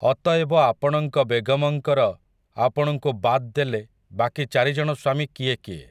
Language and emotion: Odia, neutral